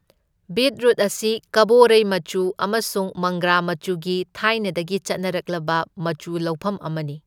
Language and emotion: Manipuri, neutral